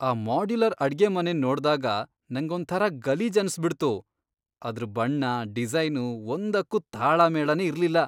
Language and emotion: Kannada, disgusted